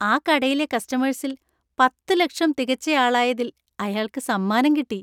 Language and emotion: Malayalam, happy